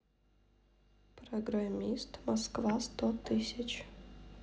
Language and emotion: Russian, neutral